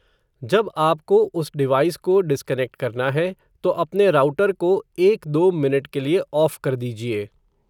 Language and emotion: Hindi, neutral